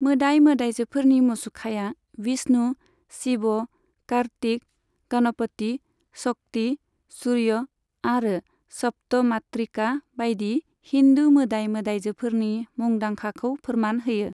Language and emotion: Bodo, neutral